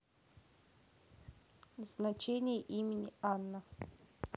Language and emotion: Russian, neutral